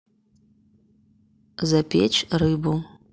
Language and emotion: Russian, neutral